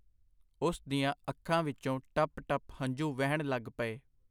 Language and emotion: Punjabi, neutral